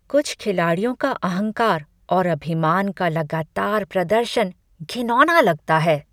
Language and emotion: Hindi, disgusted